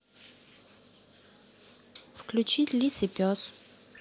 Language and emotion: Russian, neutral